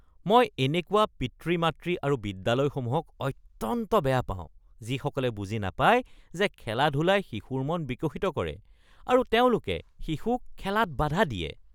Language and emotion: Assamese, disgusted